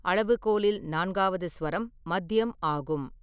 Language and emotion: Tamil, neutral